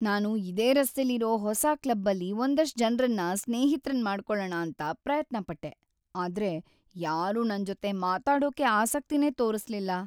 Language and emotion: Kannada, sad